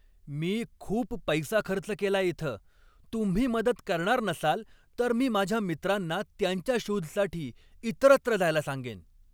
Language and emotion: Marathi, angry